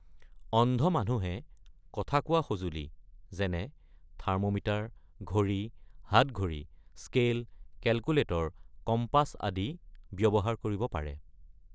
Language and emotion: Assamese, neutral